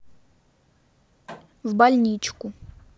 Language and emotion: Russian, neutral